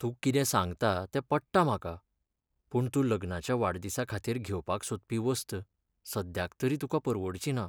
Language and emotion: Goan Konkani, sad